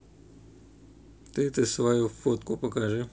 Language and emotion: Russian, neutral